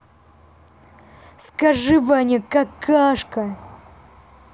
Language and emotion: Russian, angry